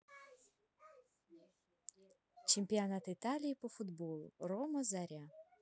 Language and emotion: Russian, neutral